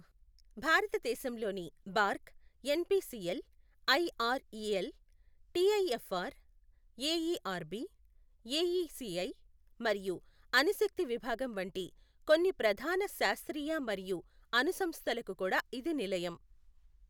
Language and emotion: Telugu, neutral